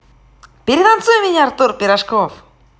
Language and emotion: Russian, positive